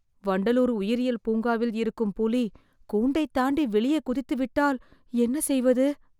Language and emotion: Tamil, fearful